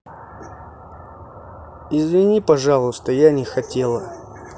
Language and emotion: Russian, sad